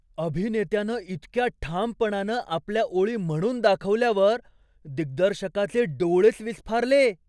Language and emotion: Marathi, surprised